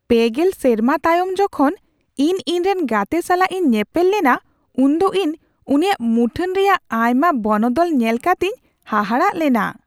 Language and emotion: Santali, surprised